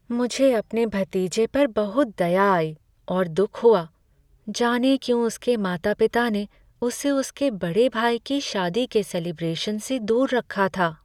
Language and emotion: Hindi, sad